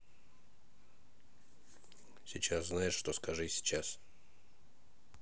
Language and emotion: Russian, neutral